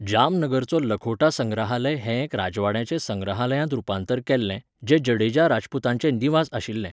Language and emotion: Goan Konkani, neutral